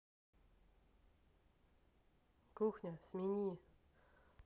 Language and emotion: Russian, neutral